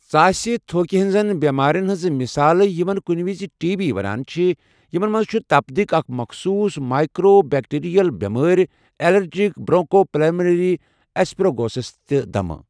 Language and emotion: Kashmiri, neutral